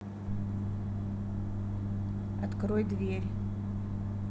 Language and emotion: Russian, neutral